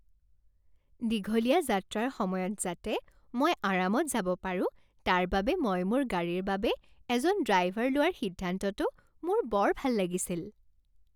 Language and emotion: Assamese, happy